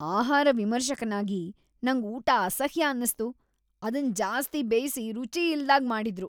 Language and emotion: Kannada, disgusted